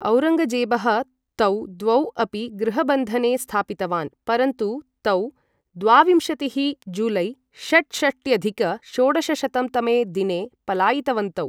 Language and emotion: Sanskrit, neutral